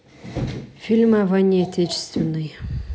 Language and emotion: Russian, neutral